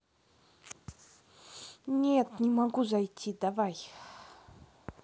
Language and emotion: Russian, neutral